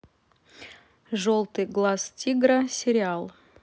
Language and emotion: Russian, neutral